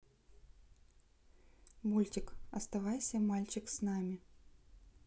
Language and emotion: Russian, neutral